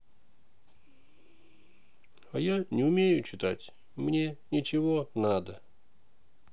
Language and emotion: Russian, sad